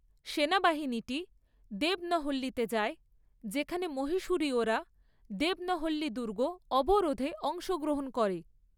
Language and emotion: Bengali, neutral